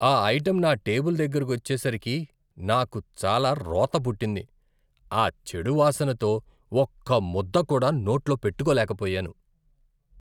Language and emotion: Telugu, disgusted